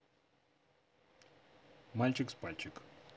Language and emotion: Russian, neutral